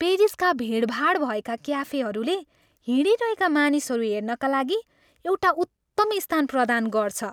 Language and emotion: Nepali, happy